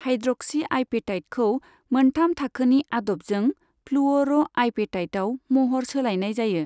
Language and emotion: Bodo, neutral